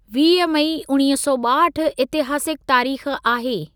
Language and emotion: Sindhi, neutral